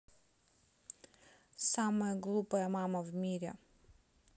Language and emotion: Russian, neutral